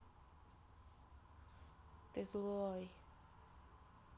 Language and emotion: Russian, neutral